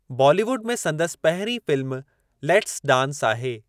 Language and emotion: Sindhi, neutral